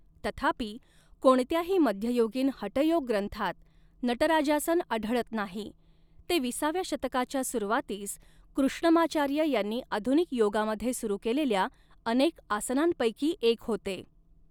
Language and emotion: Marathi, neutral